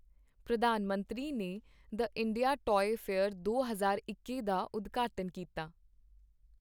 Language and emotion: Punjabi, neutral